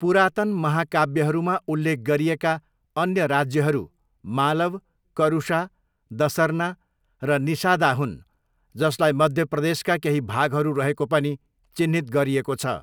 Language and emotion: Nepali, neutral